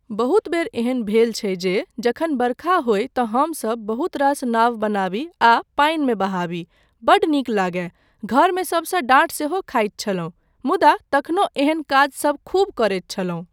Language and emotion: Maithili, neutral